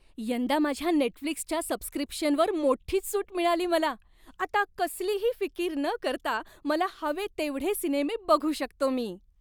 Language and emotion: Marathi, happy